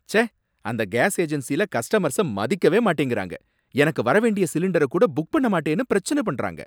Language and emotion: Tamil, angry